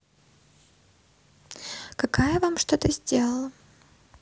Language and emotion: Russian, neutral